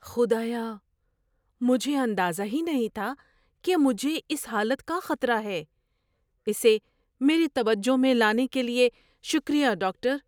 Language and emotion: Urdu, surprised